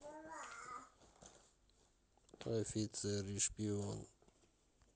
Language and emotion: Russian, neutral